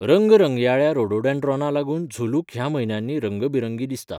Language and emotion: Goan Konkani, neutral